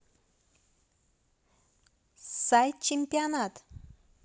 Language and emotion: Russian, positive